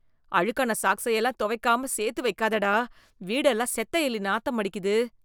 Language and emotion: Tamil, disgusted